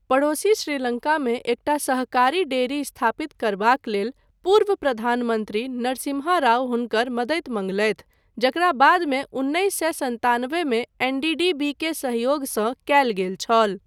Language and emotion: Maithili, neutral